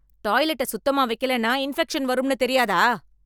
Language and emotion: Tamil, angry